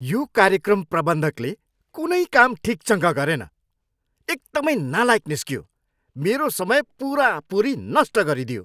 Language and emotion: Nepali, angry